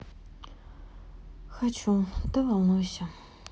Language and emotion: Russian, sad